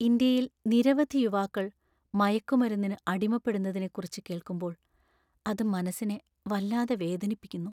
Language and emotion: Malayalam, sad